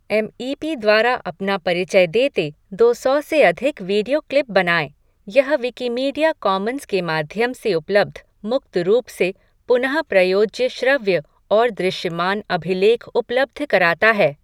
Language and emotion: Hindi, neutral